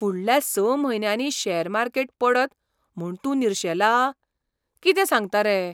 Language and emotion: Goan Konkani, surprised